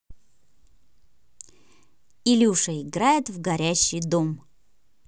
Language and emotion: Russian, positive